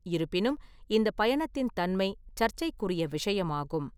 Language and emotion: Tamil, neutral